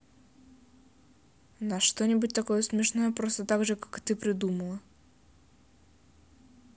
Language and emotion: Russian, neutral